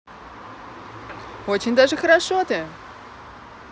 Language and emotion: Russian, positive